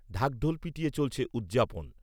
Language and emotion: Bengali, neutral